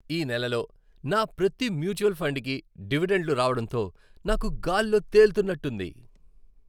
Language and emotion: Telugu, happy